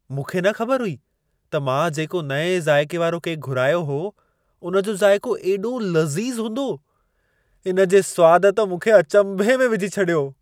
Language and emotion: Sindhi, surprised